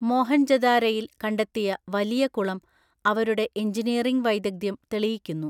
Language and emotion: Malayalam, neutral